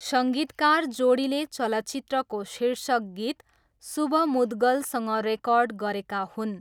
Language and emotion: Nepali, neutral